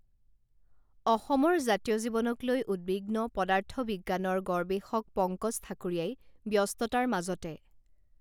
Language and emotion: Assamese, neutral